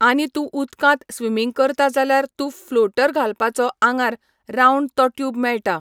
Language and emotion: Goan Konkani, neutral